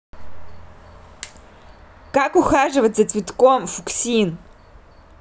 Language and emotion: Russian, neutral